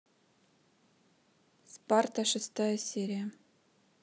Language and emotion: Russian, neutral